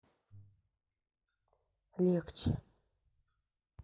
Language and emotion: Russian, sad